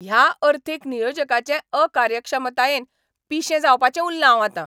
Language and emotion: Goan Konkani, angry